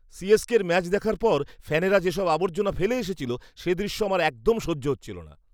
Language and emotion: Bengali, disgusted